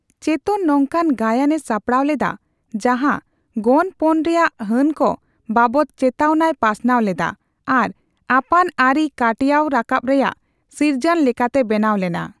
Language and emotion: Santali, neutral